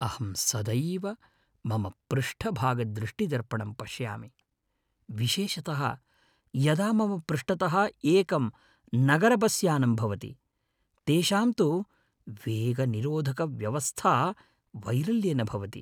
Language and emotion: Sanskrit, fearful